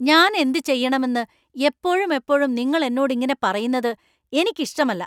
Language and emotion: Malayalam, angry